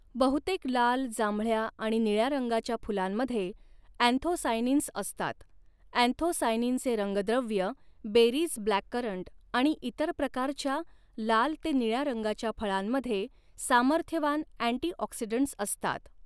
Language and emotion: Marathi, neutral